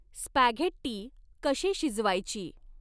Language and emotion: Marathi, neutral